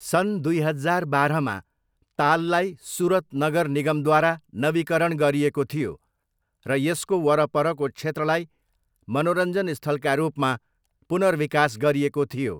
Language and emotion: Nepali, neutral